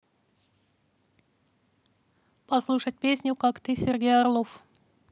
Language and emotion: Russian, neutral